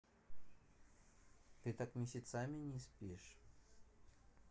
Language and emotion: Russian, neutral